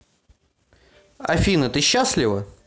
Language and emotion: Russian, neutral